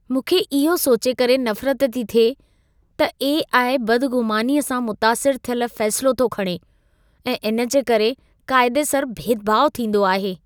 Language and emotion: Sindhi, disgusted